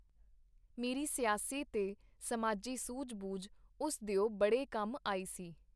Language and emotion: Punjabi, neutral